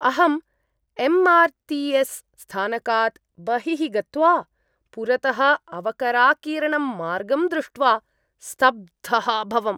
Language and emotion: Sanskrit, disgusted